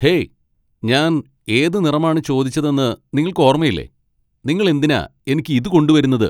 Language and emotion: Malayalam, angry